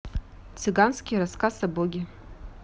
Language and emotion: Russian, neutral